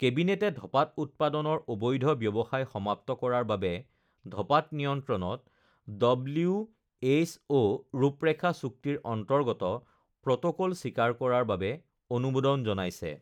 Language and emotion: Assamese, neutral